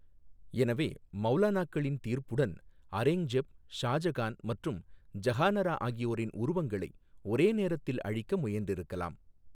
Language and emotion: Tamil, neutral